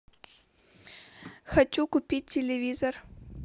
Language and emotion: Russian, neutral